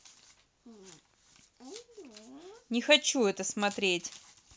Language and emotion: Russian, angry